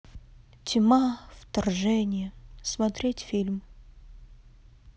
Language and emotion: Russian, neutral